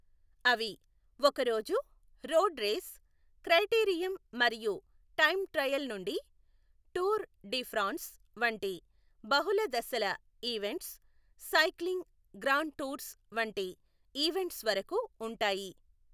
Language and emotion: Telugu, neutral